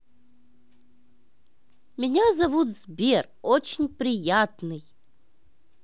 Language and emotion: Russian, positive